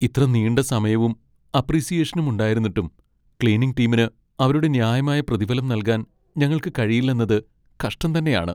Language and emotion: Malayalam, sad